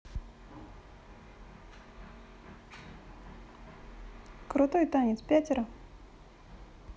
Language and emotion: Russian, neutral